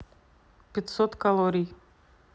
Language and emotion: Russian, neutral